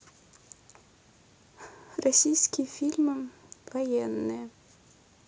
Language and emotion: Russian, neutral